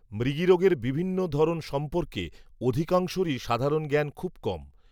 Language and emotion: Bengali, neutral